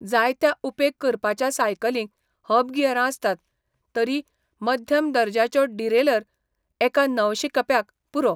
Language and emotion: Goan Konkani, neutral